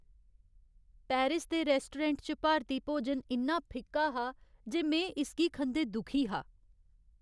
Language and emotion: Dogri, sad